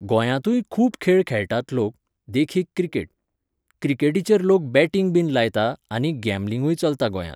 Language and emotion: Goan Konkani, neutral